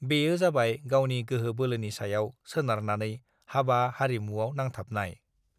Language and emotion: Bodo, neutral